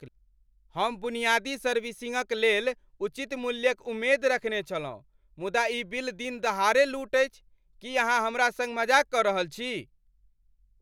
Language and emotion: Maithili, angry